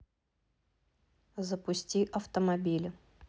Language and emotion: Russian, neutral